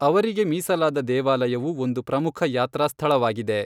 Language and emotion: Kannada, neutral